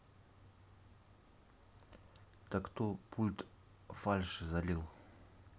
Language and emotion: Russian, neutral